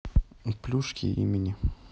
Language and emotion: Russian, neutral